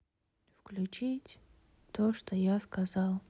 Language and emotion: Russian, sad